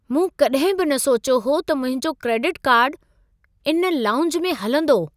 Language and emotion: Sindhi, surprised